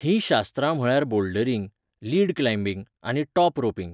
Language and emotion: Goan Konkani, neutral